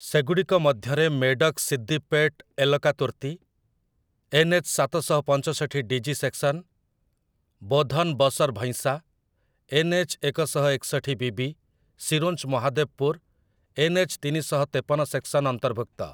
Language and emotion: Odia, neutral